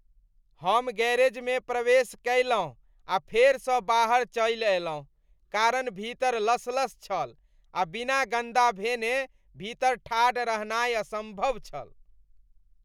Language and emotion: Maithili, disgusted